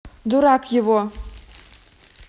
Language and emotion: Russian, angry